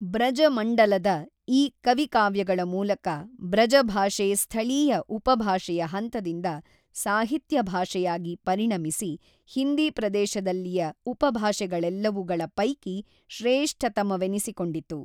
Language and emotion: Kannada, neutral